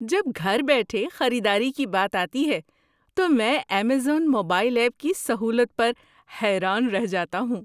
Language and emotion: Urdu, surprised